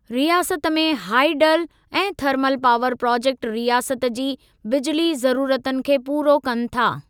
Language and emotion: Sindhi, neutral